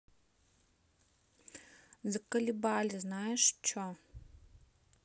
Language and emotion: Russian, angry